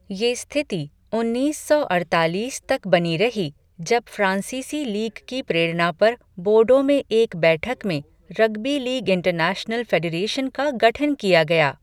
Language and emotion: Hindi, neutral